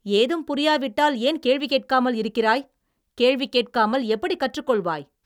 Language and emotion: Tamil, angry